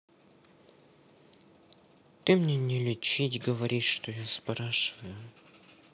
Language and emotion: Russian, sad